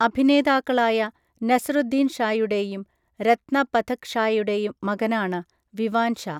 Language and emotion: Malayalam, neutral